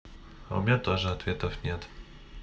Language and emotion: Russian, neutral